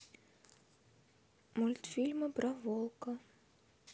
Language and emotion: Russian, neutral